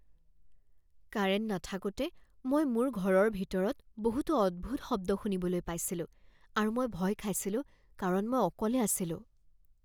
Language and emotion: Assamese, fearful